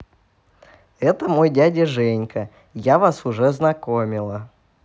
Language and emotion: Russian, positive